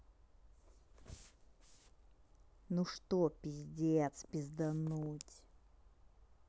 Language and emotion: Russian, angry